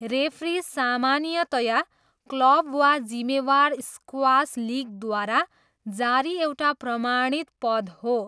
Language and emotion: Nepali, neutral